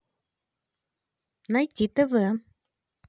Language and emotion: Russian, positive